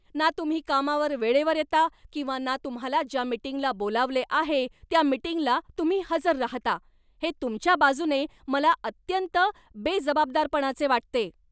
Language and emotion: Marathi, angry